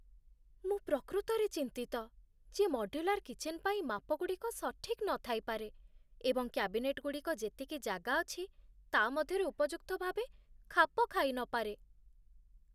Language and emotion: Odia, fearful